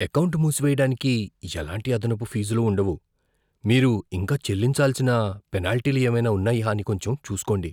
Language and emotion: Telugu, fearful